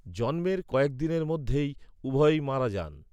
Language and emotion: Bengali, neutral